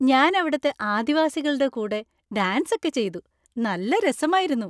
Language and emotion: Malayalam, happy